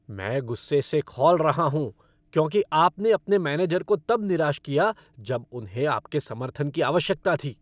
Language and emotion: Hindi, angry